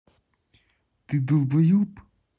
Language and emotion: Russian, angry